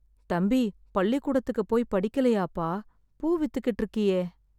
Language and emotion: Tamil, sad